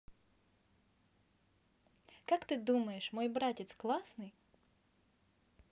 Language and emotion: Russian, positive